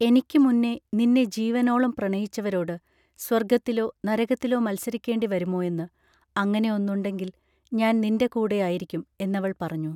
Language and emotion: Malayalam, neutral